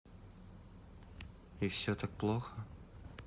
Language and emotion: Russian, sad